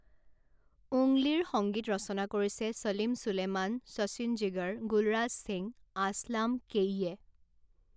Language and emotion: Assamese, neutral